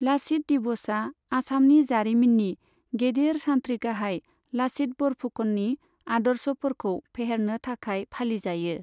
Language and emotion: Bodo, neutral